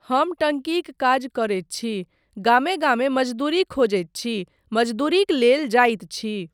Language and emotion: Maithili, neutral